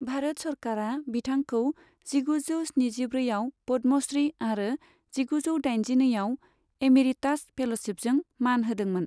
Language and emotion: Bodo, neutral